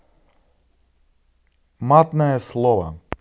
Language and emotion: Russian, neutral